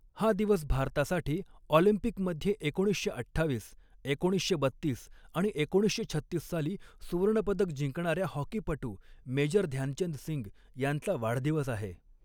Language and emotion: Marathi, neutral